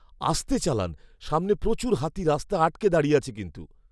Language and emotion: Bengali, fearful